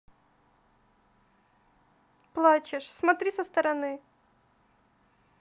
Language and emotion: Russian, neutral